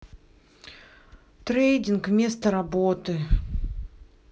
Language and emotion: Russian, sad